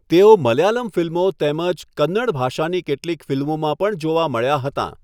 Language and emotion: Gujarati, neutral